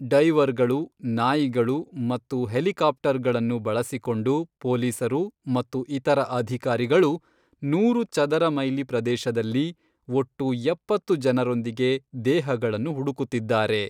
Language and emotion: Kannada, neutral